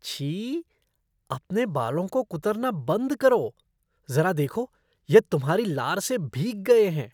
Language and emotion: Hindi, disgusted